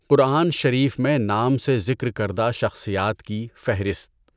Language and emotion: Urdu, neutral